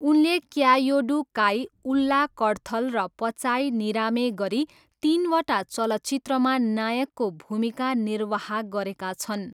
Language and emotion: Nepali, neutral